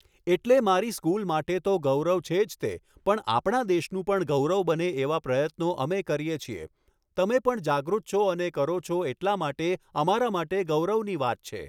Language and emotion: Gujarati, neutral